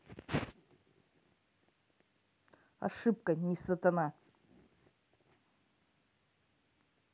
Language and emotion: Russian, neutral